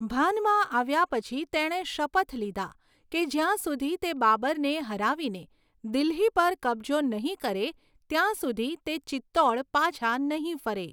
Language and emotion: Gujarati, neutral